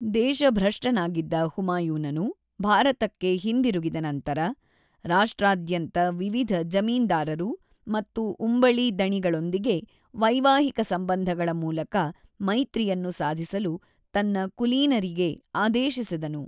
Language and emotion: Kannada, neutral